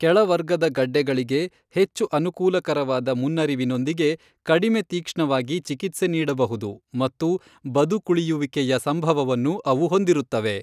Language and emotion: Kannada, neutral